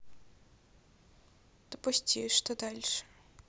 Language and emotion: Russian, neutral